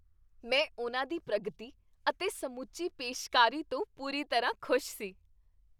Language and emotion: Punjabi, happy